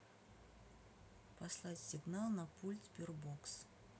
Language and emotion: Russian, neutral